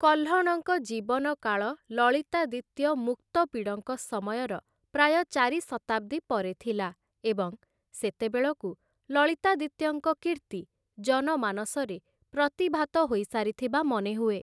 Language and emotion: Odia, neutral